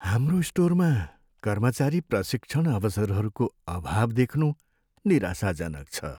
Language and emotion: Nepali, sad